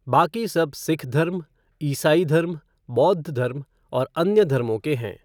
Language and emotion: Hindi, neutral